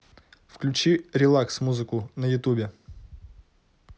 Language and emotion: Russian, neutral